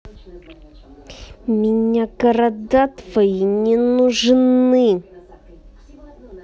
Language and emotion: Russian, angry